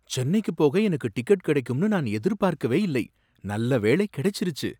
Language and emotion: Tamil, surprised